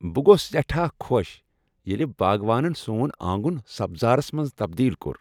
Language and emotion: Kashmiri, happy